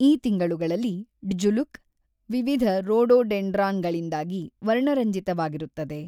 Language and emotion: Kannada, neutral